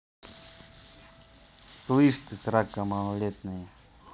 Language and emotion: Russian, neutral